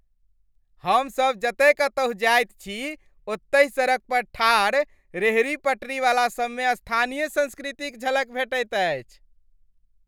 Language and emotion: Maithili, happy